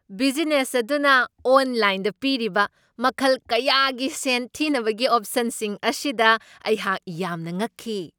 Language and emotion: Manipuri, surprised